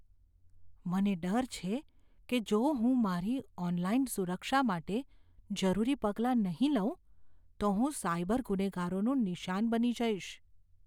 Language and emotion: Gujarati, fearful